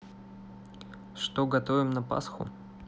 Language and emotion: Russian, neutral